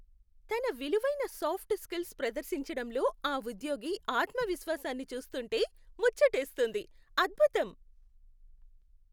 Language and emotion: Telugu, happy